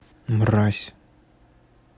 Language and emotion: Russian, angry